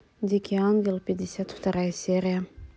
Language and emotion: Russian, neutral